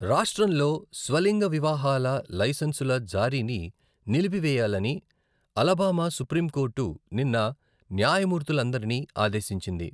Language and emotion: Telugu, neutral